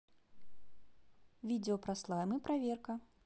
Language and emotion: Russian, neutral